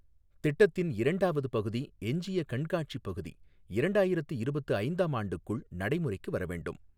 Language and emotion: Tamil, neutral